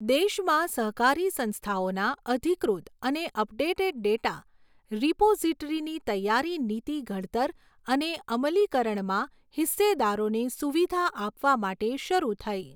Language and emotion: Gujarati, neutral